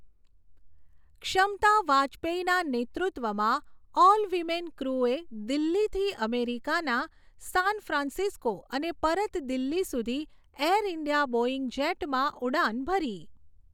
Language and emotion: Gujarati, neutral